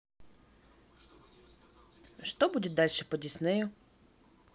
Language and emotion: Russian, neutral